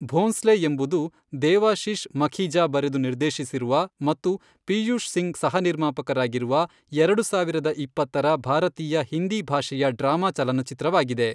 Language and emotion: Kannada, neutral